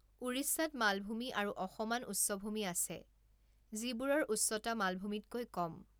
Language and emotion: Assamese, neutral